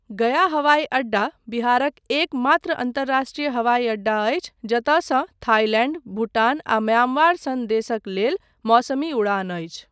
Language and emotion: Maithili, neutral